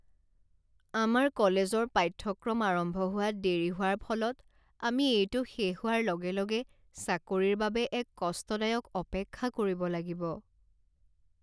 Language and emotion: Assamese, sad